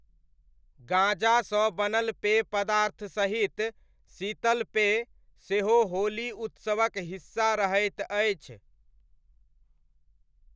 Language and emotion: Maithili, neutral